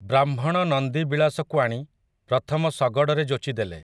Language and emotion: Odia, neutral